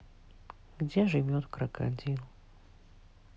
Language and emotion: Russian, sad